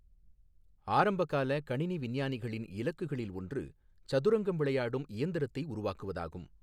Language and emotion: Tamil, neutral